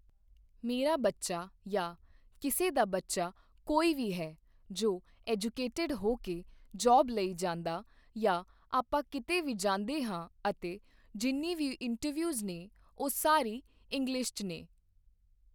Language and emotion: Punjabi, neutral